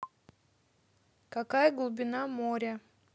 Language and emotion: Russian, neutral